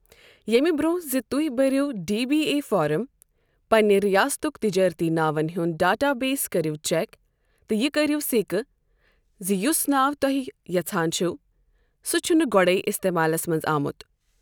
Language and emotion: Kashmiri, neutral